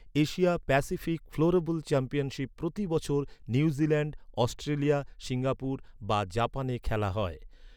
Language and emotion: Bengali, neutral